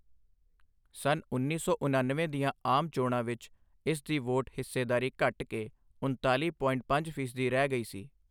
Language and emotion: Punjabi, neutral